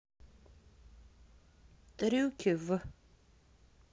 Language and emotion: Russian, neutral